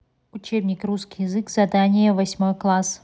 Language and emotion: Russian, neutral